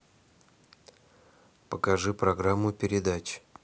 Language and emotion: Russian, neutral